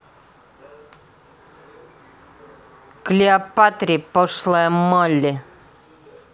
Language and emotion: Russian, angry